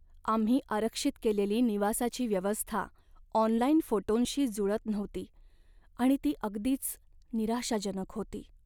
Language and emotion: Marathi, sad